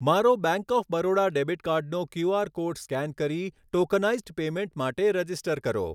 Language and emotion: Gujarati, neutral